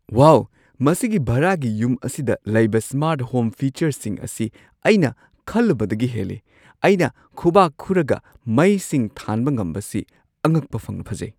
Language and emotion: Manipuri, surprised